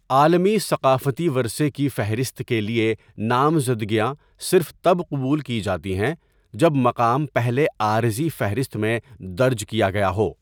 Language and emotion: Urdu, neutral